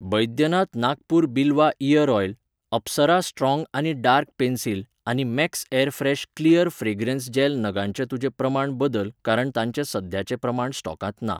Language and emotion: Goan Konkani, neutral